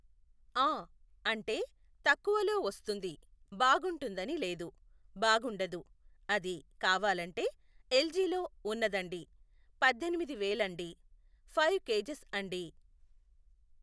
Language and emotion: Telugu, neutral